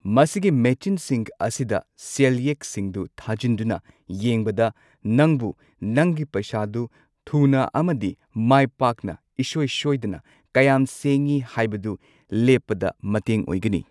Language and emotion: Manipuri, neutral